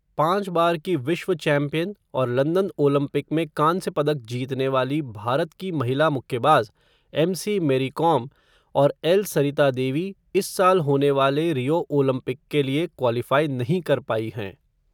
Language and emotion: Hindi, neutral